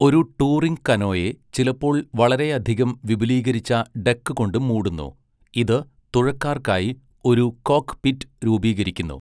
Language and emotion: Malayalam, neutral